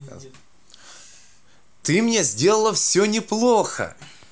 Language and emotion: Russian, positive